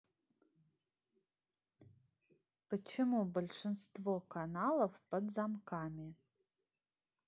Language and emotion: Russian, neutral